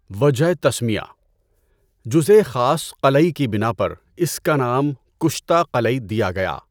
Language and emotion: Urdu, neutral